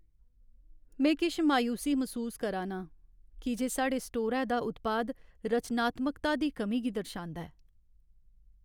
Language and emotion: Dogri, sad